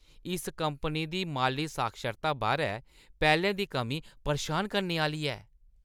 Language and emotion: Dogri, disgusted